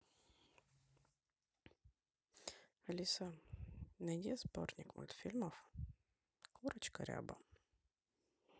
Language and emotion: Russian, neutral